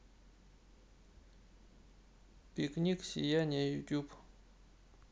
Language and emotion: Russian, neutral